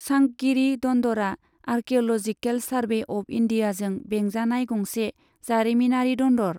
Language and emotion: Bodo, neutral